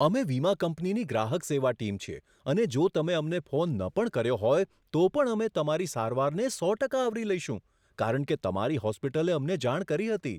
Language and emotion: Gujarati, surprised